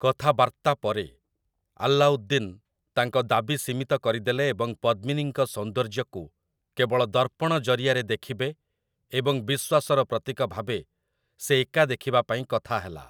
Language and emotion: Odia, neutral